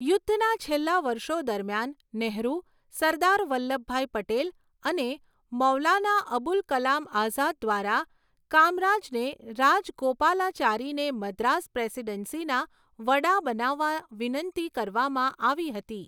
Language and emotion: Gujarati, neutral